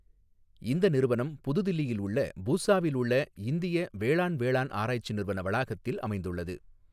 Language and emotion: Tamil, neutral